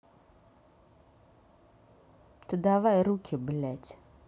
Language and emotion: Russian, angry